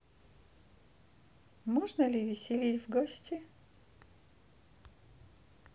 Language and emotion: Russian, positive